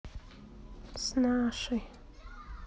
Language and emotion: Russian, sad